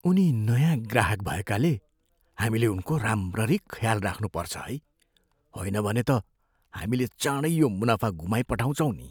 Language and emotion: Nepali, fearful